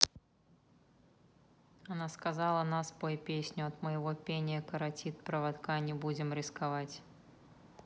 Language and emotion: Russian, neutral